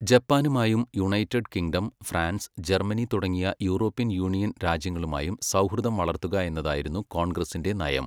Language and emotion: Malayalam, neutral